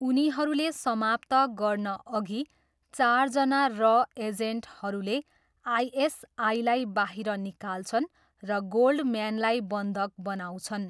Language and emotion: Nepali, neutral